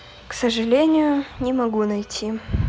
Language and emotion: Russian, sad